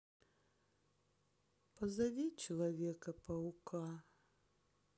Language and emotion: Russian, sad